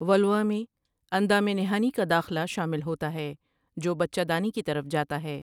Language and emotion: Urdu, neutral